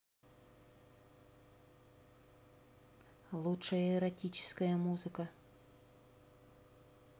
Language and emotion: Russian, neutral